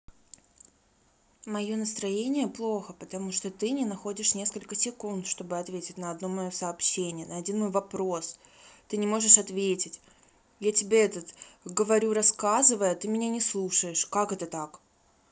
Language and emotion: Russian, sad